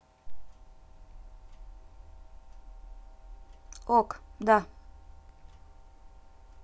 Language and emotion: Russian, neutral